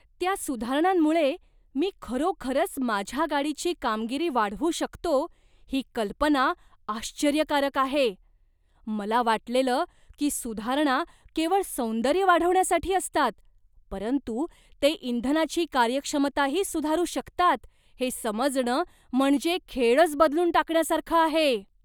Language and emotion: Marathi, surprised